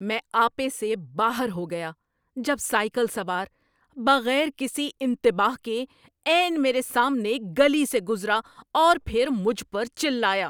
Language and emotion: Urdu, angry